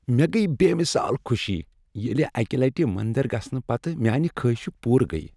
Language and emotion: Kashmiri, happy